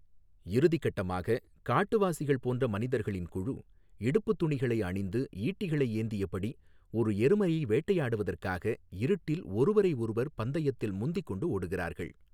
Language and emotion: Tamil, neutral